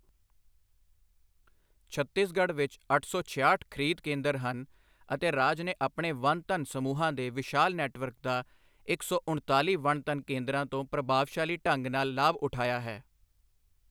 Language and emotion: Punjabi, neutral